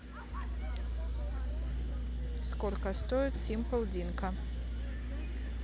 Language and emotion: Russian, neutral